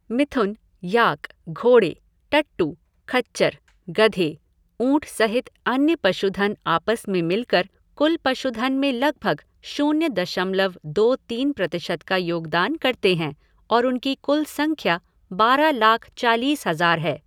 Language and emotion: Hindi, neutral